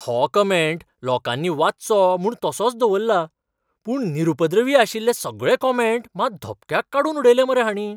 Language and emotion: Goan Konkani, surprised